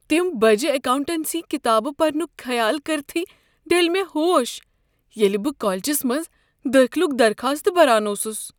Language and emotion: Kashmiri, fearful